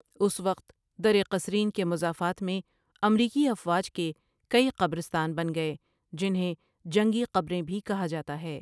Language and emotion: Urdu, neutral